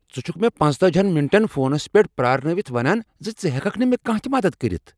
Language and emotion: Kashmiri, angry